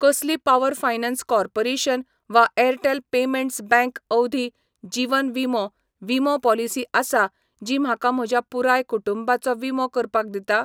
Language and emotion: Goan Konkani, neutral